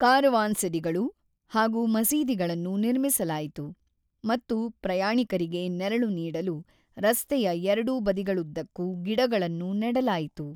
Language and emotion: Kannada, neutral